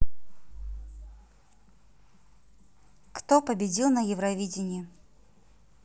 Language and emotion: Russian, neutral